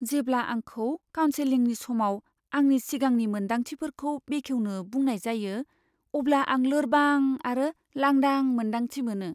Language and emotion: Bodo, fearful